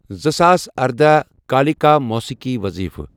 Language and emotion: Kashmiri, neutral